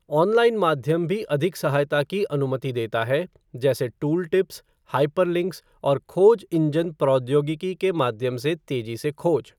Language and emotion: Hindi, neutral